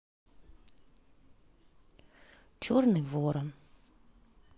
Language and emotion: Russian, sad